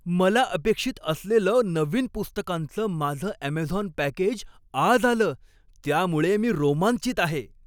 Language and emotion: Marathi, happy